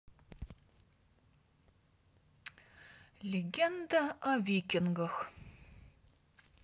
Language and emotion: Russian, neutral